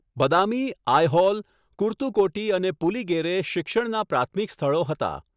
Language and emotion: Gujarati, neutral